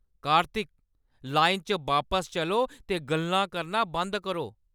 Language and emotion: Dogri, angry